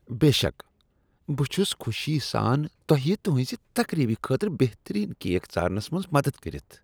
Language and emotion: Kashmiri, disgusted